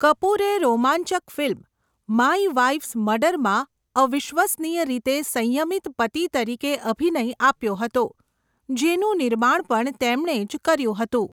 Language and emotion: Gujarati, neutral